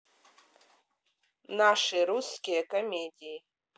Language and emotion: Russian, neutral